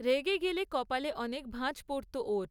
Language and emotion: Bengali, neutral